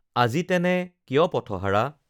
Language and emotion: Assamese, neutral